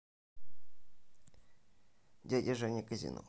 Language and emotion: Russian, neutral